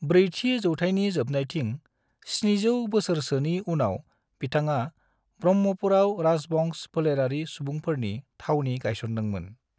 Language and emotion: Bodo, neutral